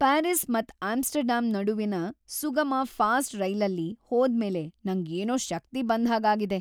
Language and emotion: Kannada, happy